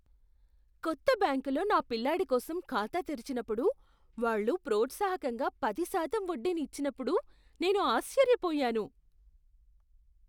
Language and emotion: Telugu, surprised